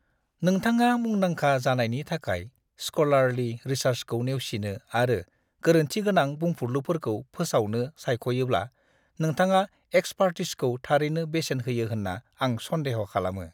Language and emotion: Bodo, disgusted